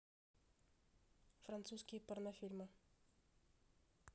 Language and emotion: Russian, neutral